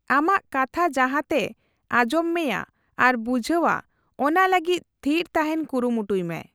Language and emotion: Santali, neutral